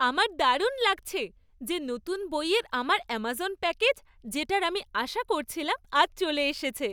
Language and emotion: Bengali, happy